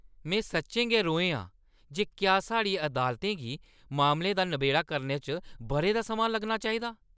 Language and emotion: Dogri, angry